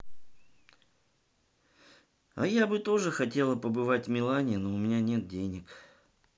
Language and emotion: Russian, neutral